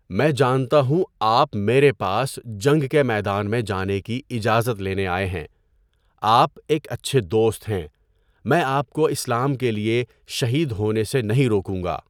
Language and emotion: Urdu, neutral